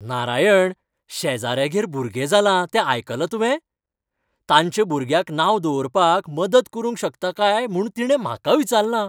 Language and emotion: Goan Konkani, happy